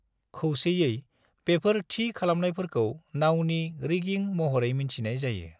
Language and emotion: Bodo, neutral